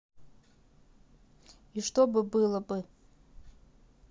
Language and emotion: Russian, neutral